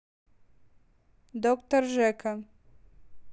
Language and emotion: Russian, neutral